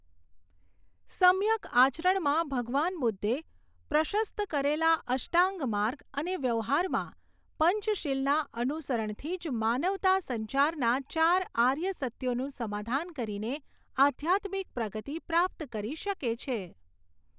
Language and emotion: Gujarati, neutral